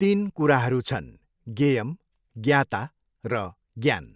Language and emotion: Nepali, neutral